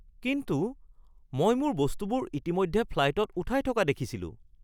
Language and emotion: Assamese, surprised